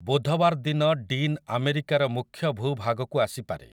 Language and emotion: Odia, neutral